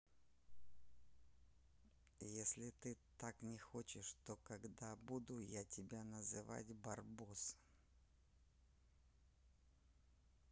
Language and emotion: Russian, neutral